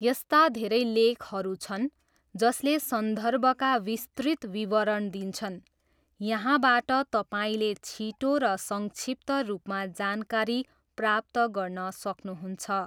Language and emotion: Nepali, neutral